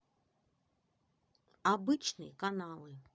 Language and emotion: Russian, neutral